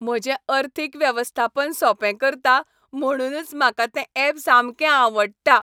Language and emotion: Goan Konkani, happy